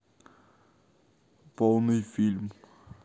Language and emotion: Russian, neutral